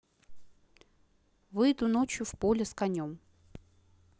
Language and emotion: Russian, neutral